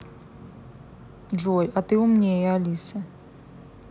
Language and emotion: Russian, neutral